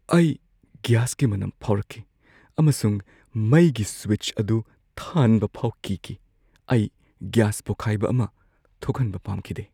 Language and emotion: Manipuri, fearful